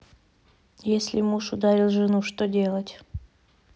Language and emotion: Russian, neutral